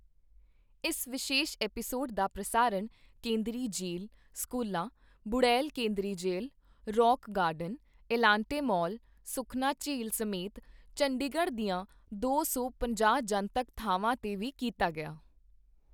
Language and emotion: Punjabi, neutral